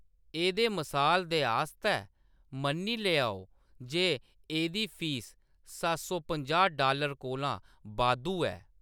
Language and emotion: Dogri, neutral